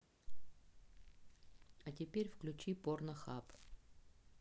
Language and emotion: Russian, neutral